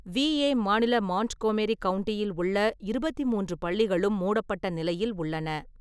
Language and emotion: Tamil, neutral